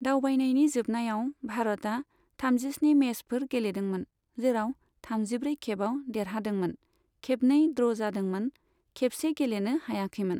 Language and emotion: Bodo, neutral